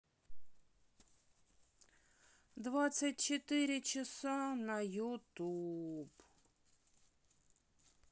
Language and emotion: Russian, sad